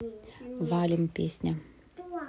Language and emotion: Russian, neutral